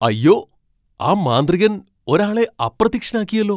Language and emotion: Malayalam, surprised